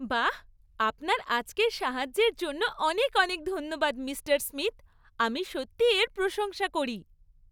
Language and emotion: Bengali, happy